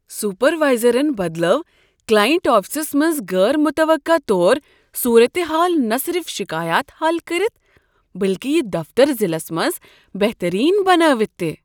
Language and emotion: Kashmiri, surprised